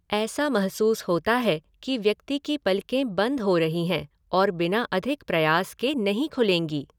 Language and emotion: Hindi, neutral